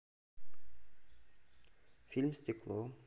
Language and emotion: Russian, neutral